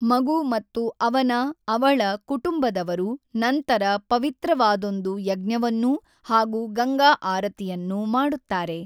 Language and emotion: Kannada, neutral